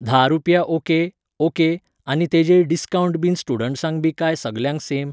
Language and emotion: Goan Konkani, neutral